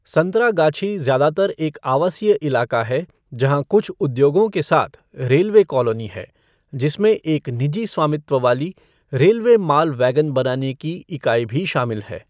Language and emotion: Hindi, neutral